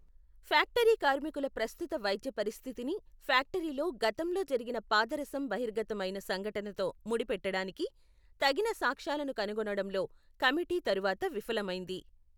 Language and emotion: Telugu, neutral